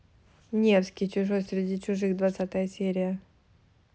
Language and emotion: Russian, neutral